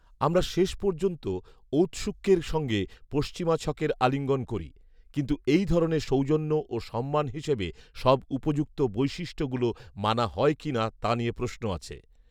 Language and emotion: Bengali, neutral